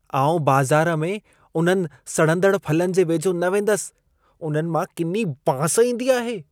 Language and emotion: Sindhi, disgusted